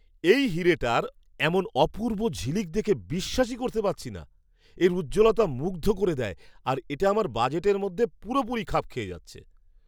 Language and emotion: Bengali, surprised